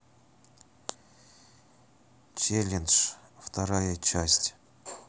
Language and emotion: Russian, neutral